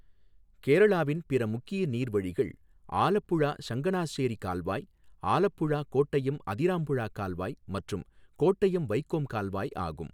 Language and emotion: Tamil, neutral